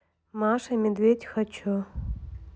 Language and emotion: Russian, neutral